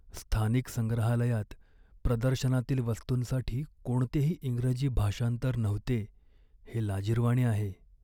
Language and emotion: Marathi, sad